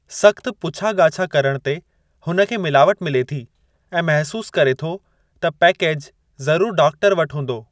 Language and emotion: Sindhi, neutral